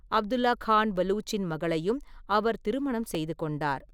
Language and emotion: Tamil, neutral